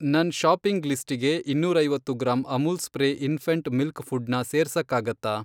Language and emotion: Kannada, neutral